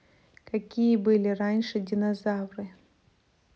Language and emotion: Russian, neutral